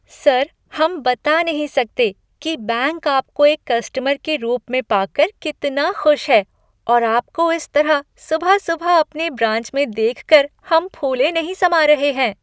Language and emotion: Hindi, happy